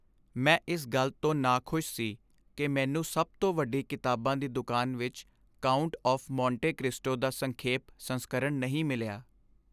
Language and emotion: Punjabi, sad